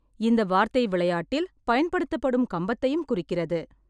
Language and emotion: Tamil, neutral